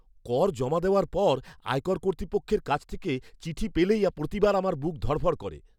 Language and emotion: Bengali, fearful